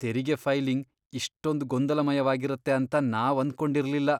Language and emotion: Kannada, disgusted